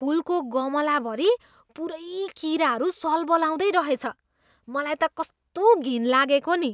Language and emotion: Nepali, disgusted